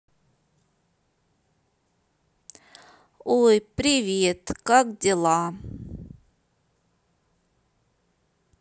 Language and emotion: Russian, neutral